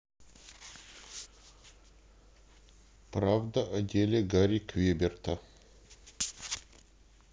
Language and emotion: Russian, neutral